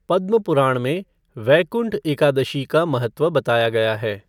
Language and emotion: Hindi, neutral